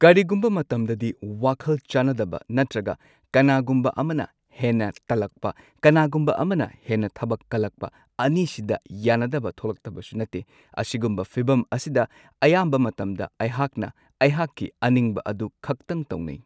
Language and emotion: Manipuri, neutral